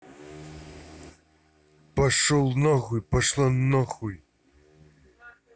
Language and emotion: Russian, angry